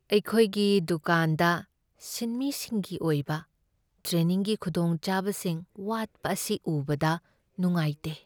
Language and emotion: Manipuri, sad